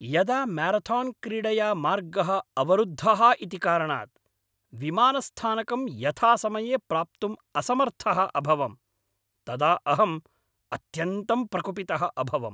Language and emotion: Sanskrit, angry